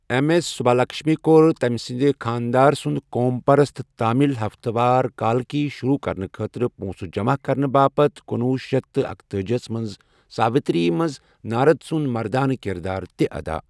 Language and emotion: Kashmiri, neutral